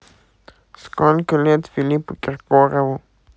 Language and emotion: Russian, neutral